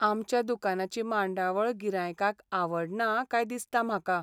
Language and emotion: Goan Konkani, sad